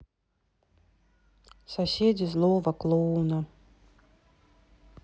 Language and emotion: Russian, sad